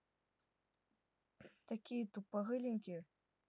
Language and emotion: Russian, neutral